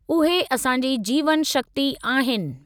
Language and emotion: Sindhi, neutral